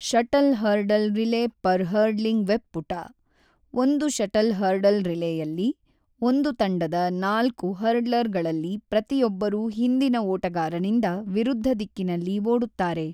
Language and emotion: Kannada, neutral